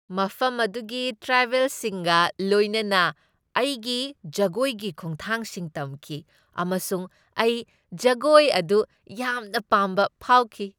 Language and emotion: Manipuri, happy